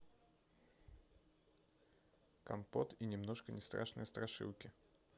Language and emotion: Russian, neutral